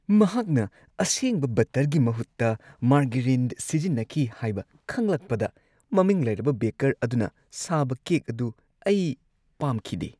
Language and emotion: Manipuri, disgusted